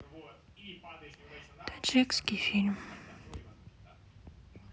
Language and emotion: Russian, sad